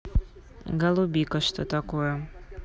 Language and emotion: Russian, neutral